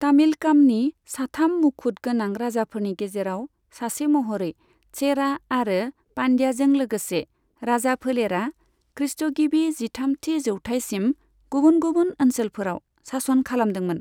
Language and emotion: Bodo, neutral